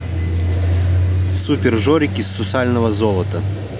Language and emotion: Russian, neutral